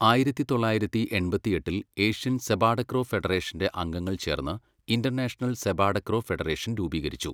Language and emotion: Malayalam, neutral